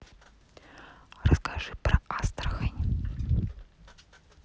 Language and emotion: Russian, neutral